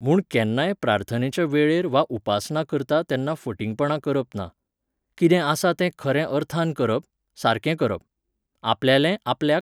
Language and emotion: Goan Konkani, neutral